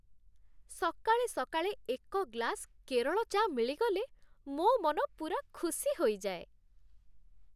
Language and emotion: Odia, happy